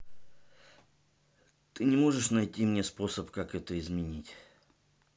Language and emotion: Russian, neutral